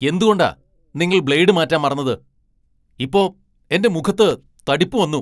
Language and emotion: Malayalam, angry